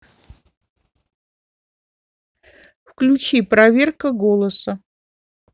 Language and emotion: Russian, neutral